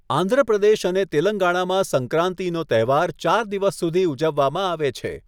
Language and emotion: Gujarati, neutral